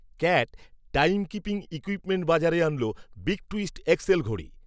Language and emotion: Bengali, neutral